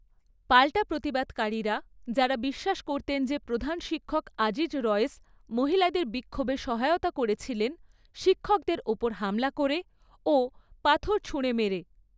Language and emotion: Bengali, neutral